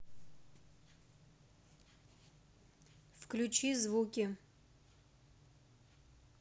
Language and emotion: Russian, neutral